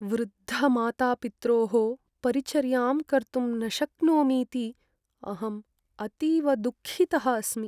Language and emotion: Sanskrit, sad